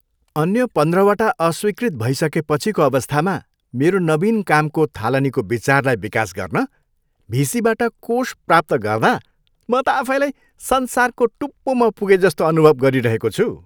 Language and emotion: Nepali, happy